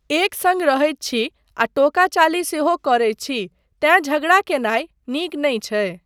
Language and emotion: Maithili, neutral